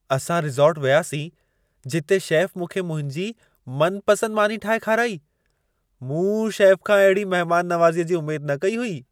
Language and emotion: Sindhi, surprised